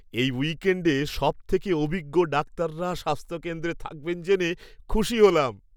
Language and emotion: Bengali, happy